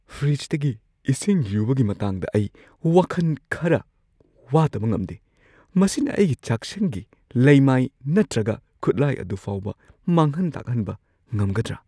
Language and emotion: Manipuri, fearful